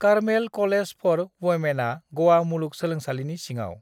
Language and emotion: Bodo, neutral